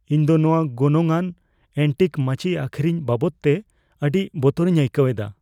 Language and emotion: Santali, fearful